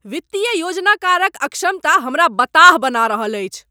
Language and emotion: Maithili, angry